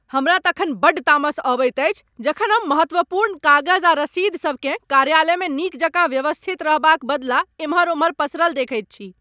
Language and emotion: Maithili, angry